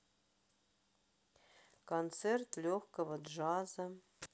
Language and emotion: Russian, sad